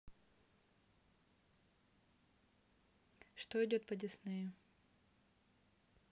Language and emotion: Russian, neutral